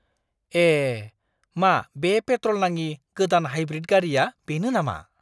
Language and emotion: Bodo, surprised